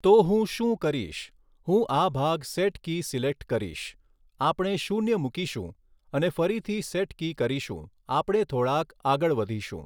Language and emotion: Gujarati, neutral